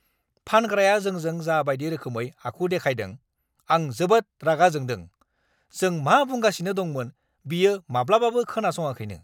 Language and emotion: Bodo, angry